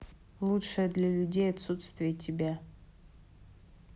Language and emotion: Russian, neutral